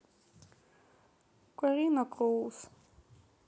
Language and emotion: Russian, sad